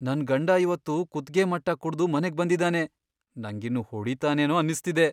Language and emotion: Kannada, fearful